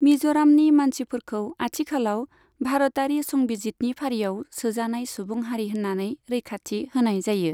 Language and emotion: Bodo, neutral